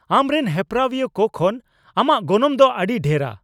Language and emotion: Santali, angry